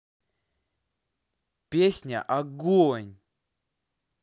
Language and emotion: Russian, positive